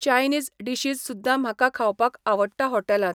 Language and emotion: Goan Konkani, neutral